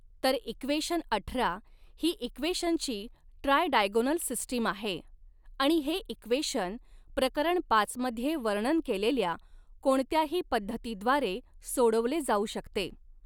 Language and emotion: Marathi, neutral